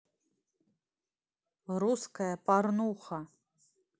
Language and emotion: Russian, neutral